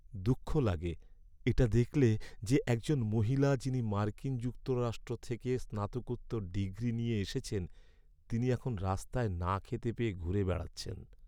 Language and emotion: Bengali, sad